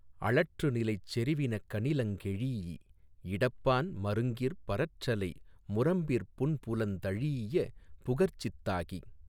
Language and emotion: Tamil, neutral